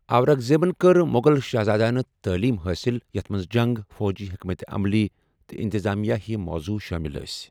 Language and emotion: Kashmiri, neutral